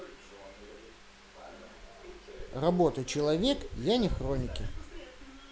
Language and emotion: Russian, neutral